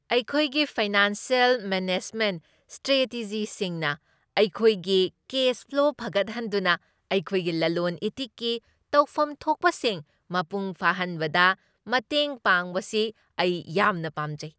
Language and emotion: Manipuri, happy